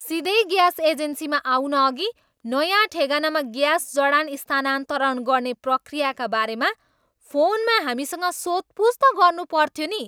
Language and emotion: Nepali, angry